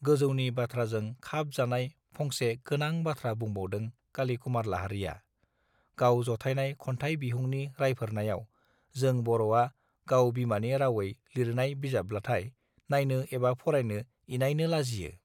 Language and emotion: Bodo, neutral